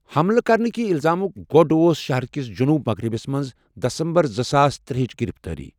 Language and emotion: Kashmiri, neutral